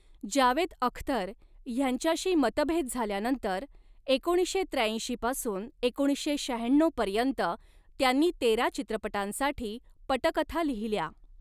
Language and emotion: Marathi, neutral